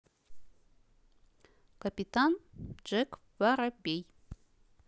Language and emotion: Russian, neutral